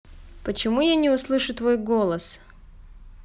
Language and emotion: Russian, neutral